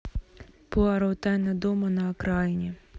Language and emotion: Russian, neutral